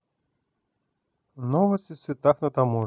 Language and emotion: Russian, neutral